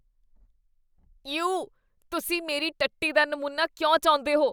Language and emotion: Punjabi, disgusted